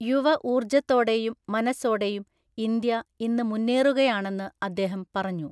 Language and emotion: Malayalam, neutral